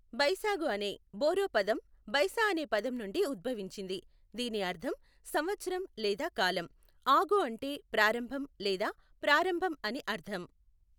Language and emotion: Telugu, neutral